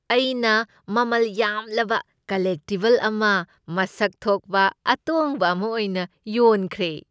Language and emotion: Manipuri, happy